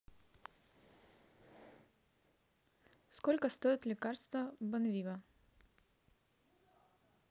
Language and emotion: Russian, neutral